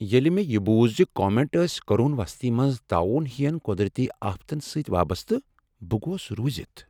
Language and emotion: Kashmiri, sad